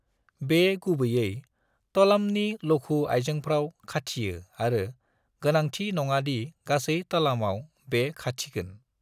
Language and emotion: Bodo, neutral